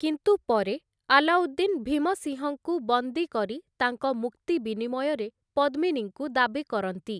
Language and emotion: Odia, neutral